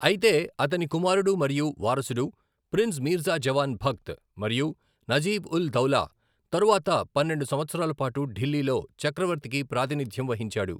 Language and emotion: Telugu, neutral